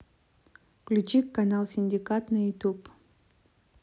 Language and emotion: Russian, neutral